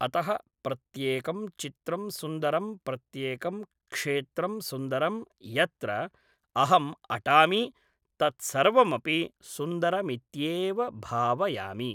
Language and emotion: Sanskrit, neutral